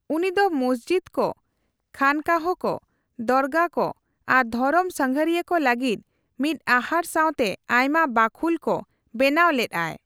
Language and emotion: Santali, neutral